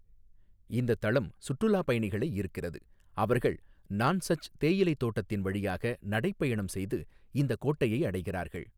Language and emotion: Tamil, neutral